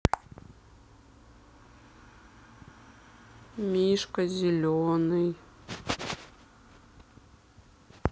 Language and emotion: Russian, sad